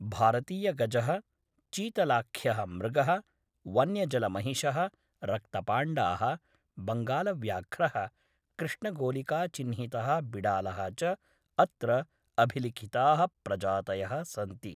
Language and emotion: Sanskrit, neutral